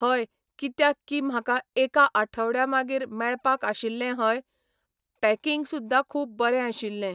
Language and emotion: Goan Konkani, neutral